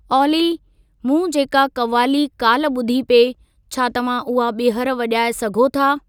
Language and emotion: Sindhi, neutral